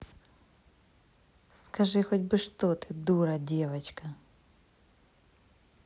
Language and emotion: Russian, angry